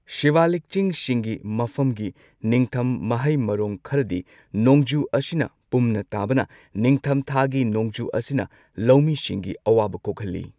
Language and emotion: Manipuri, neutral